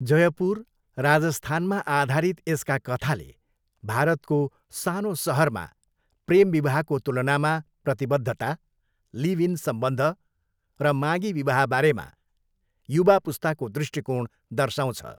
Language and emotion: Nepali, neutral